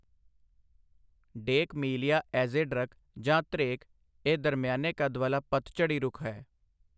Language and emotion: Punjabi, neutral